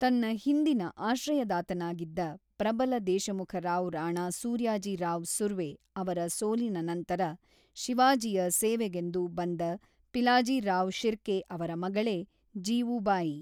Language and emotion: Kannada, neutral